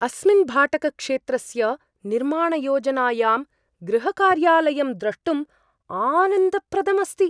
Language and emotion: Sanskrit, surprised